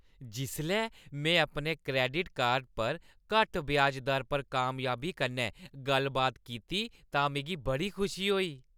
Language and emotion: Dogri, happy